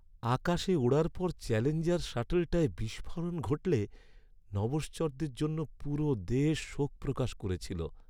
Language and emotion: Bengali, sad